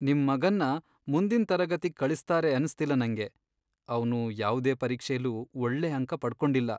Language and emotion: Kannada, sad